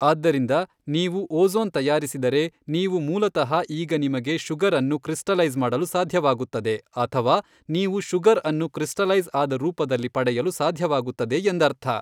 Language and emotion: Kannada, neutral